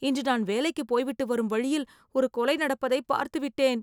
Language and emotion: Tamil, fearful